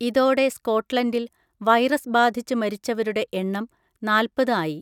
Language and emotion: Malayalam, neutral